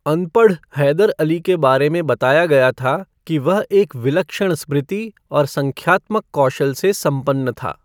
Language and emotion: Hindi, neutral